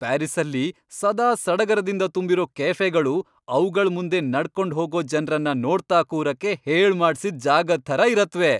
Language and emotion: Kannada, happy